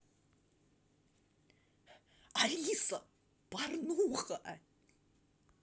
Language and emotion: Russian, positive